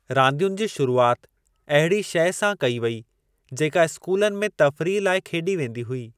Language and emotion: Sindhi, neutral